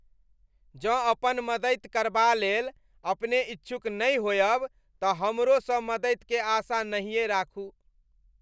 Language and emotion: Maithili, disgusted